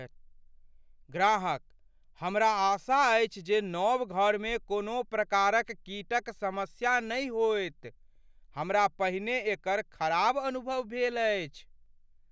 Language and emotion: Maithili, fearful